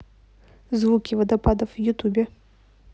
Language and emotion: Russian, neutral